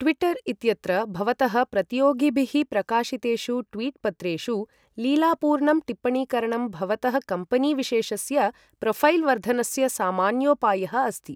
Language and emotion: Sanskrit, neutral